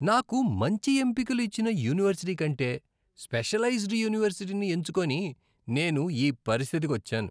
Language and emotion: Telugu, disgusted